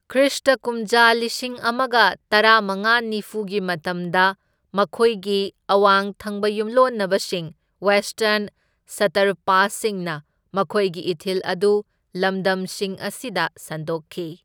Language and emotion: Manipuri, neutral